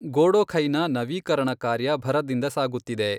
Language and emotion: Kannada, neutral